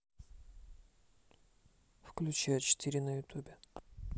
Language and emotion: Russian, neutral